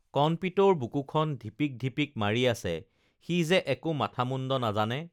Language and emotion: Assamese, neutral